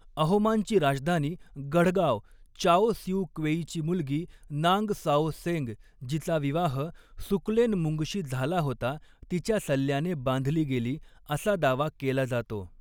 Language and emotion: Marathi, neutral